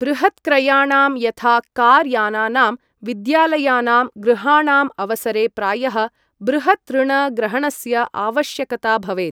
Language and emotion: Sanskrit, neutral